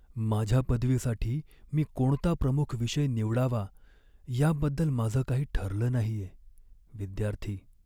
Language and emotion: Marathi, sad